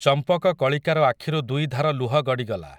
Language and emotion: Odia, neutral